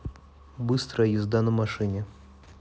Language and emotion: Russian, neutral